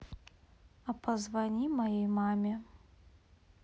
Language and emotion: Russian, neutral